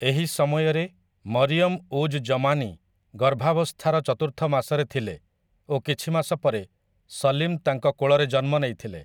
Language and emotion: Odia, neutral